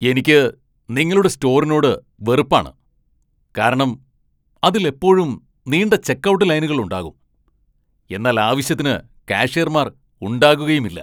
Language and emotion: Malayalam, angry